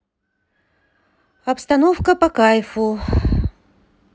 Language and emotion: Russian, sad